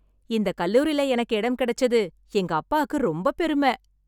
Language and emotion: Tamil, happy